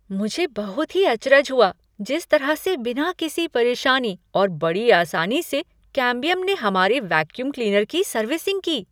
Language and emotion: Hindi, surprised